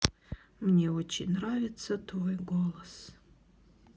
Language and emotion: Russian, sad